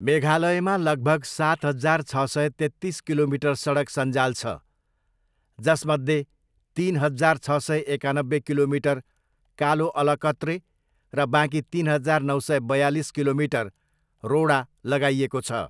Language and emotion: Nepali, neutral